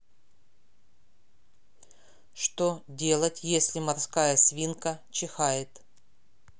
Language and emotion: Russian, neutral